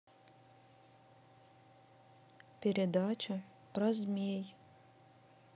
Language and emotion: Russian, neutral